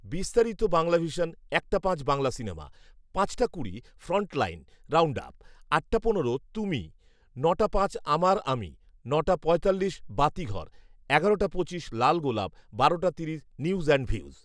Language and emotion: Bengali, neutral